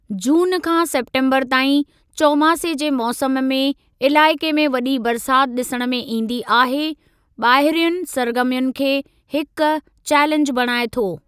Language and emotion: Sindhi, neutral